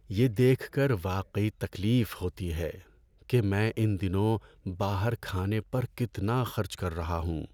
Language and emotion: Urdu, sad